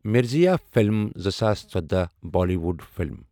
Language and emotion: Kashmiri, neutral